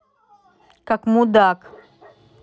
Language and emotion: Russian, angry